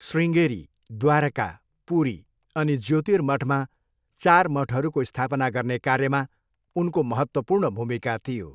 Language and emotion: Nepali, neutral